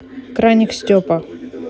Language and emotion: Russian, neutral